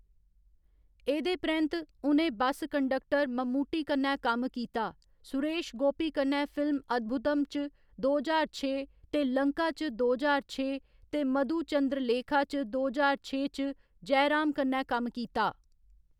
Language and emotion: Dogri, neutral